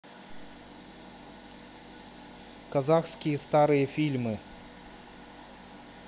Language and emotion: Russian, neutral